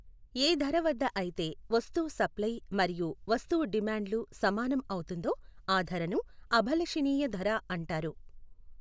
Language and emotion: Telugu, neutral